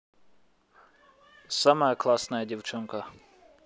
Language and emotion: Russian, positive